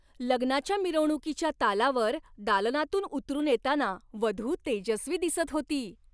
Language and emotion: Marathi, happy